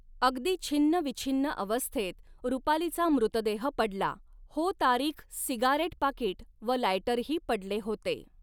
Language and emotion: Marathi, neutral